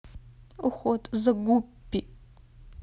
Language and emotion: Russian, sad